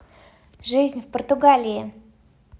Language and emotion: Russian, positive